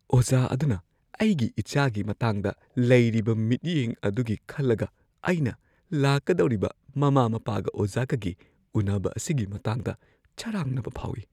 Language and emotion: Manipuri, fearful